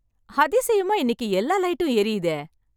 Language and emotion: Tamil, happy